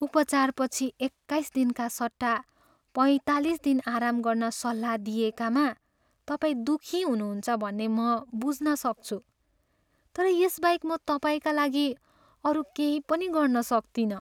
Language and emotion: Nepali, sad